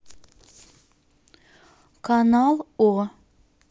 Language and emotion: Russian, neutral